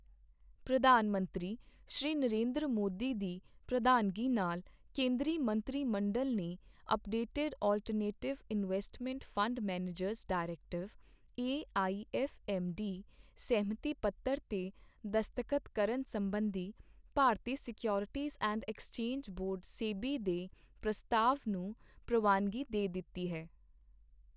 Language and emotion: Punjabi, neutral